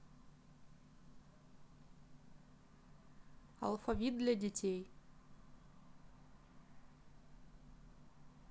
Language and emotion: Russian, neutral